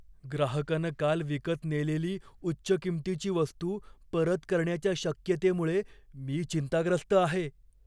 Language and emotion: Marathi, fearful